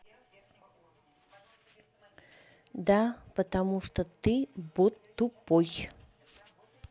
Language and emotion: Russian, neutral